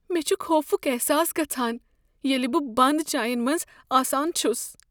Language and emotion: Kashmiri, fearful